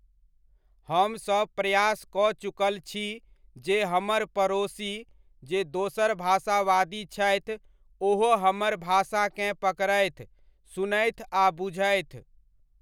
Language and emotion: Maithili, neutral